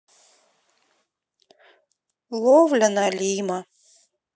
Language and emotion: Russian, sad